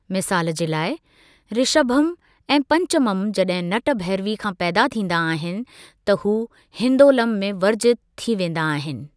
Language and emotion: Sindhi, neutral